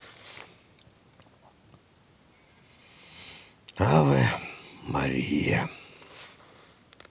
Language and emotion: Russian, sad